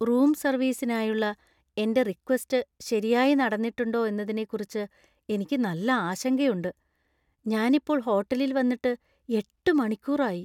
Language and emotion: Malayalam, fearful